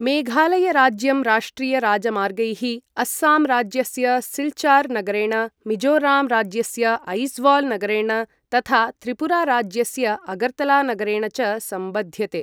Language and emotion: Sanskrit, neutral